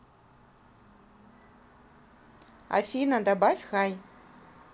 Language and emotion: Russian, neutral